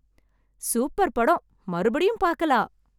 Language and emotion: Tamil, happy